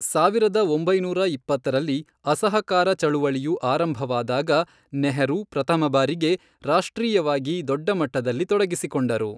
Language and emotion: Kannada, neutral